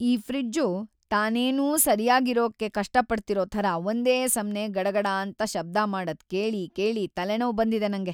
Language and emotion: Kannada, sad